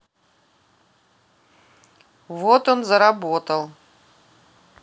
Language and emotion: Russian, neutral